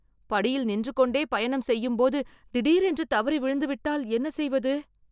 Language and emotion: Tamil, fearful